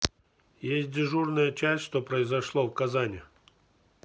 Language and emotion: Russian, neutral